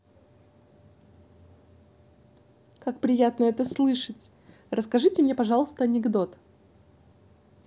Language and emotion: Russian, positive